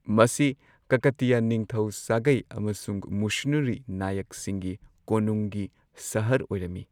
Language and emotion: Manipuri, neutral